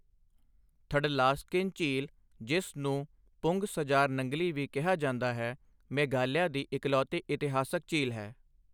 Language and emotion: Punjabi, neutral